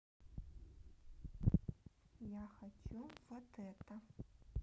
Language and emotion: Russian, neutral